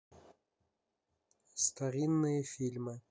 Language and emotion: Russian, neutral